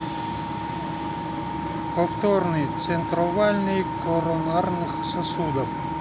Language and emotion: Russian, neutral